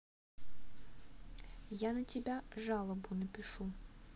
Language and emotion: Russian, neutral